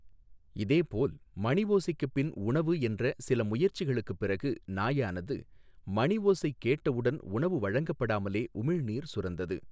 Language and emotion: Tamil, neutral